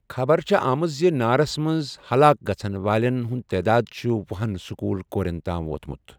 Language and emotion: Kashmiri, neutral